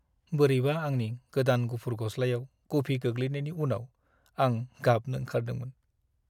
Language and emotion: Bodo, sad